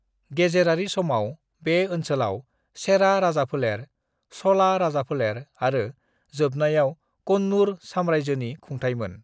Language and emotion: Bodo, neutral